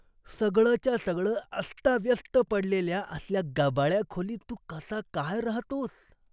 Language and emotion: Marathi, disgusted